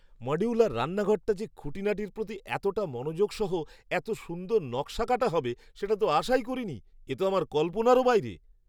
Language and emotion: Bengali, surprised